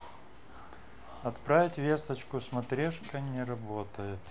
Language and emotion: Russian, neutral